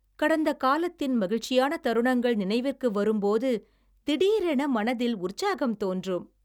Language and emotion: Tamil, happy